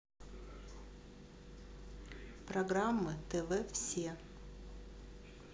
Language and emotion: Russian, neutral